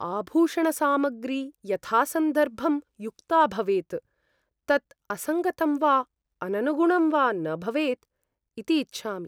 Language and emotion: Sanskrit, fearful